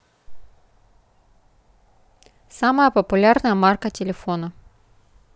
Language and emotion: Russian, neutral